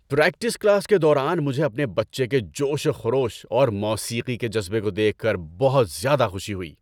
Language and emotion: Urdu, happy